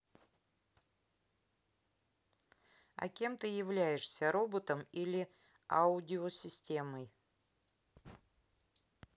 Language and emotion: Russian, neutral